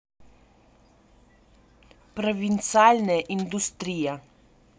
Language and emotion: Russian, neutral